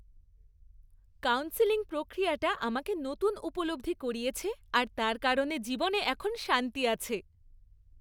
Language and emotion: Bengali, happy